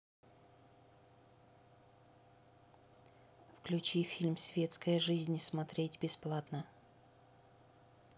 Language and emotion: Russian, neutral